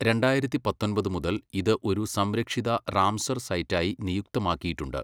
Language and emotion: Malayalam, neutral